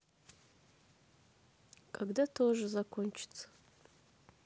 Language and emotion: Russian, sad